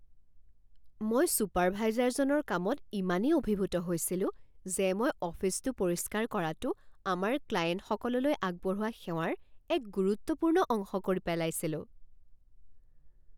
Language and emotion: Assamese, surprised